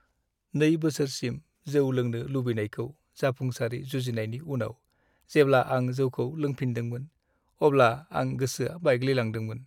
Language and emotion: Bodo, sad